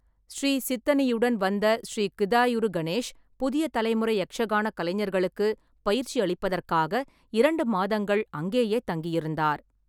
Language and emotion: Tamil, neutral